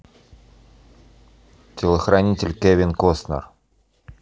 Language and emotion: Russian, neutral